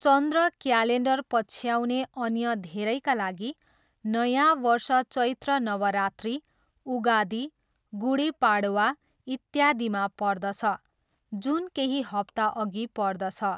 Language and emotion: Nepali, neutral